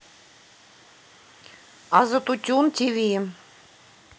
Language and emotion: Russian, neutral